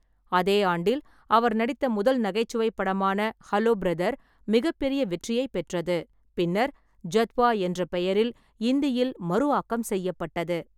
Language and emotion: Tamil, neutral